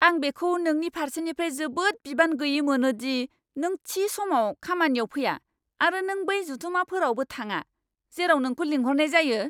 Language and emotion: Bodo, angry